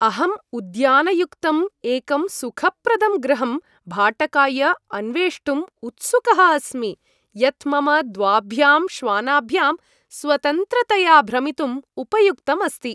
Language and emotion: Sanskrit, happy